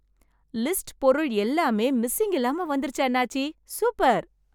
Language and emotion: Tamil, happy